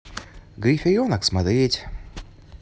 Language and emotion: Russian, neutral